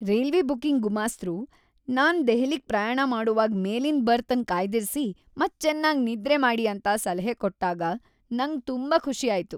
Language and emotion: Kannada, happy